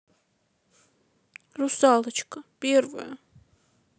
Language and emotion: Russian, sad